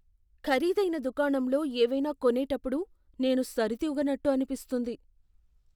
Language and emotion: Telugu, fearful